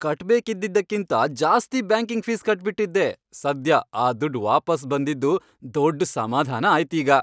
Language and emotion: Kannada, happy